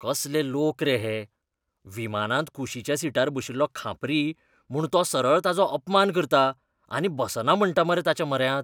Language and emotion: Goan Konkani, disgusted